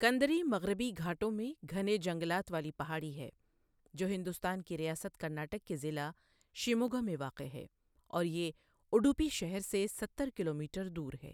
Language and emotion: Urdu, neutral